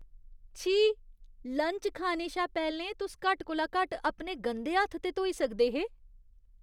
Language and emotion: Dogri, disgusted